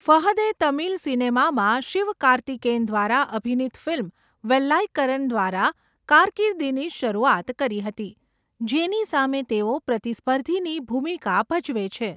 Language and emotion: Gujarati, neutral